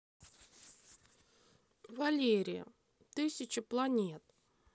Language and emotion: Russian, neutral